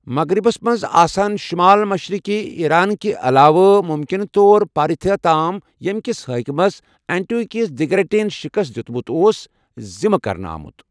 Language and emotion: Kashmiri, neutral